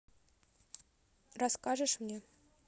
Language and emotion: Russian, neutral